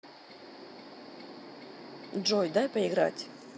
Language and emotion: Russian, neutral